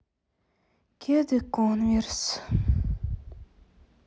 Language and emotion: Russian, sad